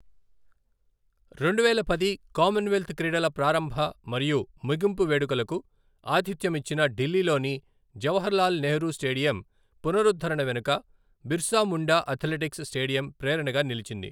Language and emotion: Telugu, neutral